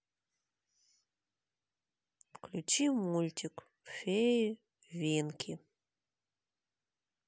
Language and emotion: Russian, sad